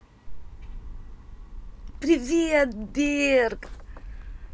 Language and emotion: Russian, positive